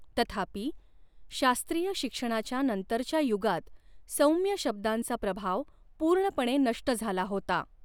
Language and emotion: Marathi, neutral